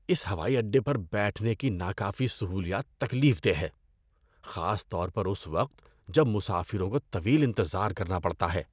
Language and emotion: Urdu, disgusted